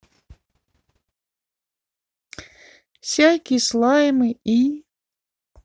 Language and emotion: Russian, sad